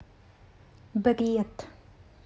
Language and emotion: Russian, neutral